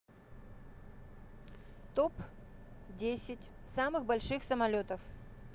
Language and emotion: Russian, neutral